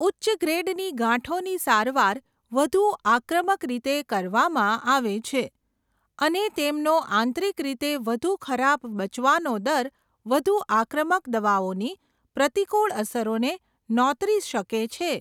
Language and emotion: Gujarati, neutral